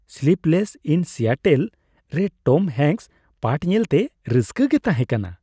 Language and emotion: Santali, happy